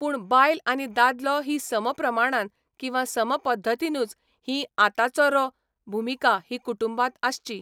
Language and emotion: Goan Konkani, neutral